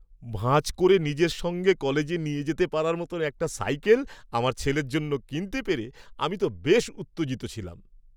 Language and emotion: Bengali, happy